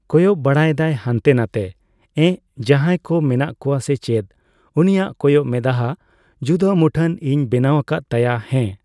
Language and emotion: Santali, neutral